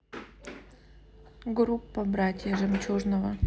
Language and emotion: Russian, neutral